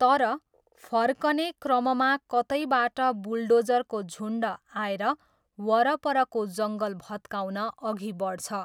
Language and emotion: Nepali, neutral